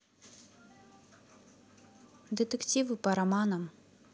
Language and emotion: Russian, neutral